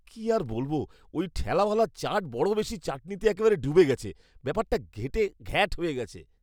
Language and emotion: Bengali, disgusted